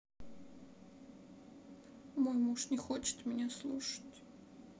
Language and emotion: Russian, sad